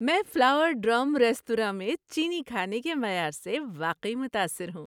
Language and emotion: Urdu, happy